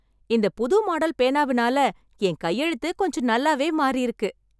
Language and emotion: Tamil, happy